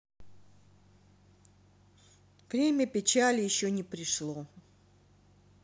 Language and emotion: Russian, sad